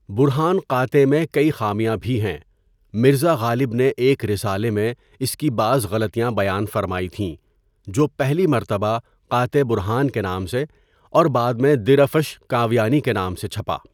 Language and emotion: Urdu, neutral